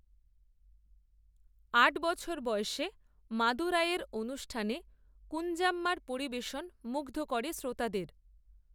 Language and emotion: Bengali, neutral